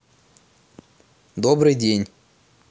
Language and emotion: Russian, neutral